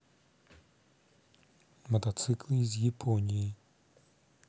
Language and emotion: Russian, neutral